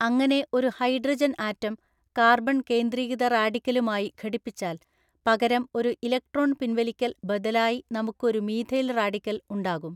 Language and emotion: Malayalam, neutral